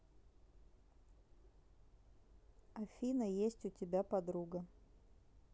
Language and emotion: Russian, neutral